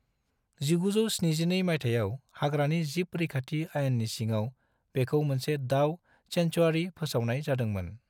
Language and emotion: Bodo, neutral